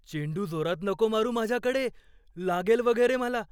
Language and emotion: Marathi, fearful